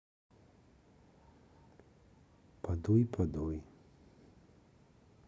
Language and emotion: Russian, sad